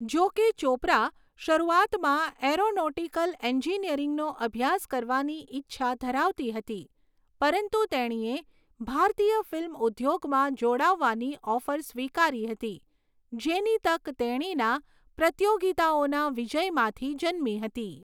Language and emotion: Gujarati, neutral